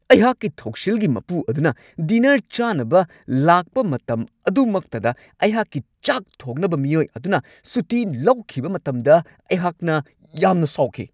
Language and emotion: Manipuri, angry